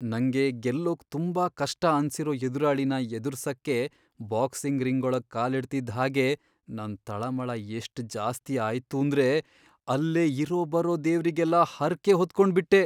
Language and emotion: Kannada, fearful